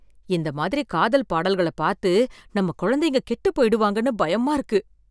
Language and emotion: Tamil, fearful